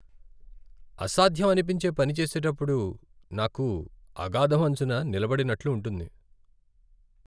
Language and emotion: Telugu, sad